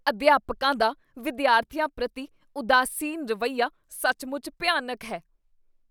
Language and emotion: Punjabi, disgusted